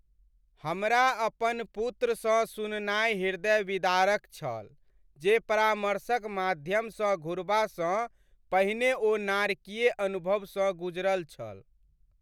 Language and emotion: Maithili, sad